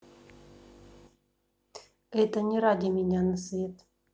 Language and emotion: Russian, neutral